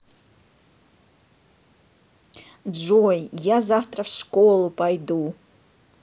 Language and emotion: Russian, positive